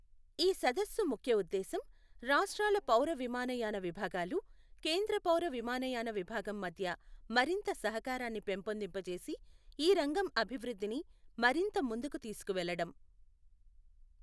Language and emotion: Telugu, neutral